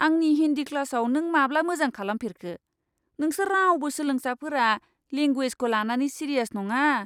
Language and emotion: Bodo, disgusted